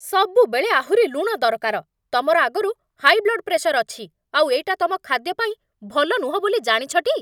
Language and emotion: Odia, angry